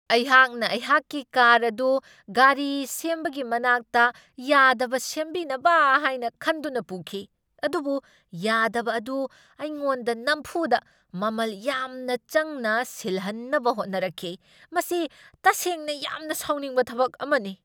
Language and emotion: Manipuri, angry